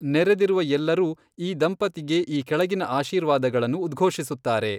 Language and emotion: Kannada, neutral